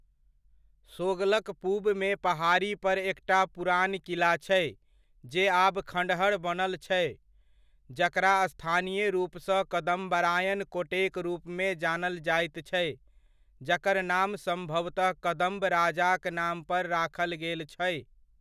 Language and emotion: Maithili, neutral